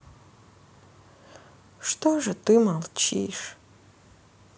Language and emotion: Russian, sad